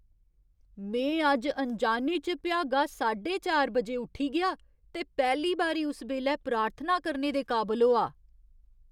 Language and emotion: Dogri, surprised